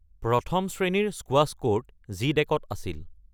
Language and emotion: Assamese, neutral